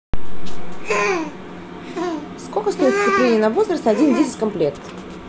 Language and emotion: Russian, neutral